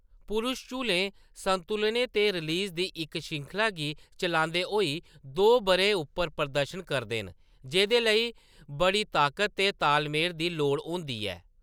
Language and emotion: Dogri, neutral